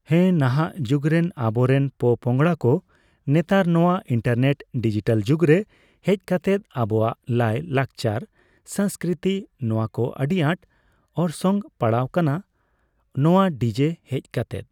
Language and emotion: Santali, neutral